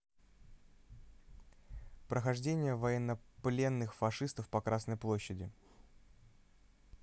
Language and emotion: Russian, neutral